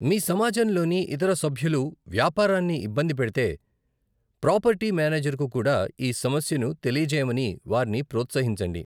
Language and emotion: Telugu, neutral